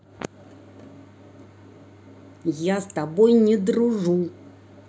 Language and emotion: Russian, angry